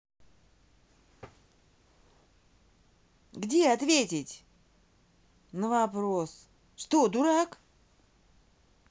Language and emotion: Russian, angry